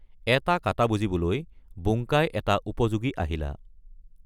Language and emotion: Assamese, neutral